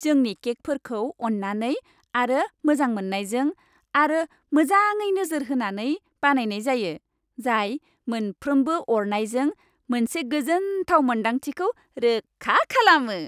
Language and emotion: Bodo, happy